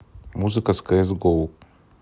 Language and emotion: Russian, neutral